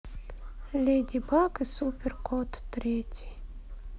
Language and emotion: Russian, sad